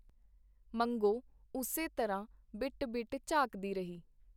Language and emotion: Punjabi, neutral